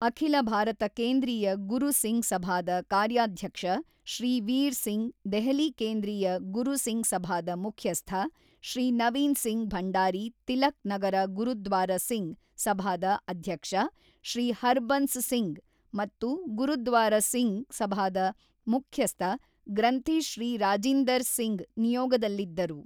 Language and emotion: Kannada, neutral